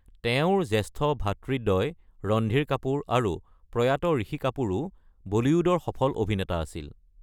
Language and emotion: Assamese, neutral